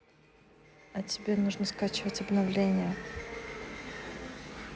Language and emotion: Russian, neutral